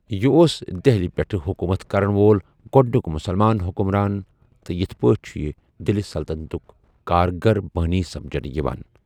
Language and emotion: Kashmiri, neutral